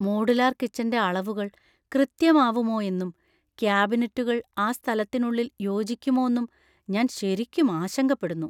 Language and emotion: Malayalam, fearful